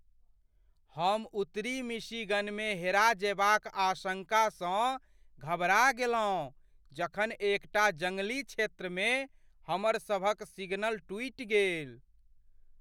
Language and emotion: Maithili, fearful